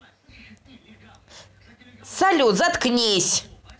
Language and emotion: Russian, angry